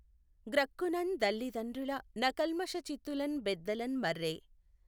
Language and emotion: Telugu, neutral